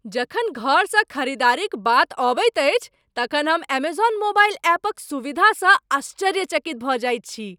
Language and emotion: Maithili, surprised